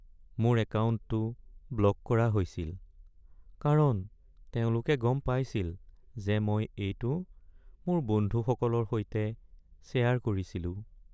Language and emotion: Assamese, sad